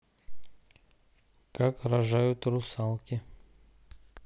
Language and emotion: Russian, neutral